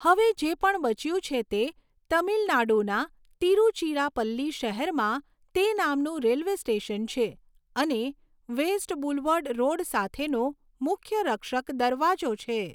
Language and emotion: Gujarati, neutral